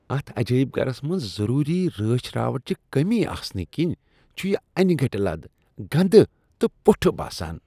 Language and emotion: Kashmiri, disgusted